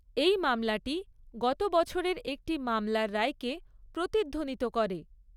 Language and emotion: Bengali, neutral